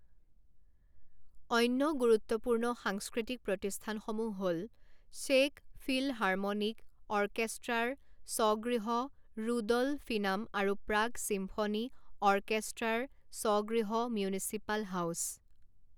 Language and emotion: Assamese, neutral